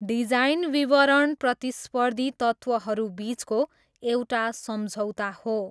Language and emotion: Nepali, neutral